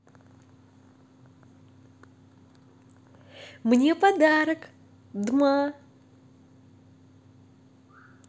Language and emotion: Russian, positive